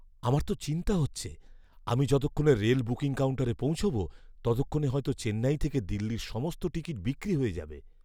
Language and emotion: Bengali, fearful